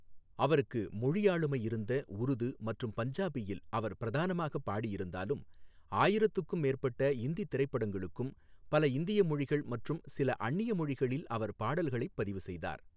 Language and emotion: Tamil, neutral